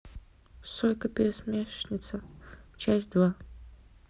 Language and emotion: Russian, neutral